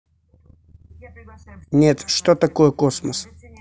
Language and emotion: Russian, neutral